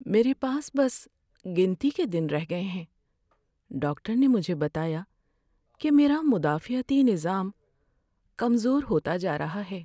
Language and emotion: Urdu, sad